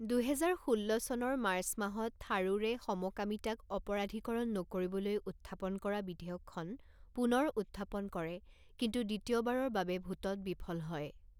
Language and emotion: Assamese, neutral